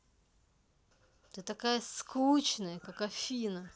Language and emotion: Russian, angry